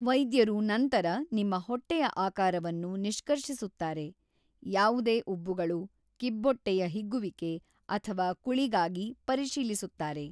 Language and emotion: Kannada, neutral